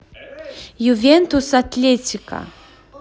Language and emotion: Russian, positive